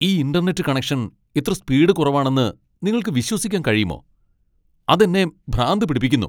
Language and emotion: Malayalam, angry